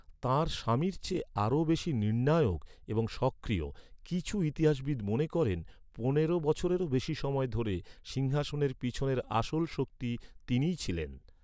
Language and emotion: Bengali, neutral